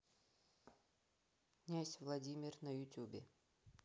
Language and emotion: Russian, neutral